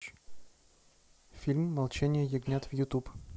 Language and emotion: Russian, neutral